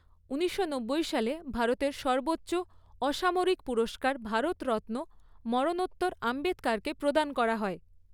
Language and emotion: Bengali, neutral